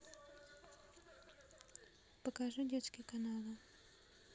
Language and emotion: Russian, neutral